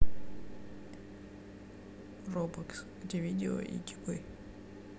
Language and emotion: Russian, neutral